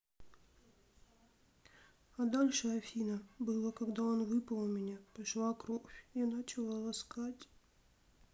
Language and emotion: Russian, sad